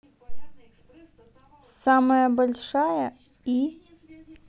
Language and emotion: Russian, neutral